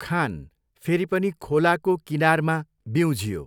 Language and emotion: Nepali, neutral